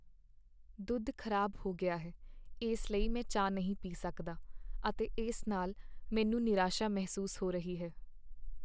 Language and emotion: Punjabi, sad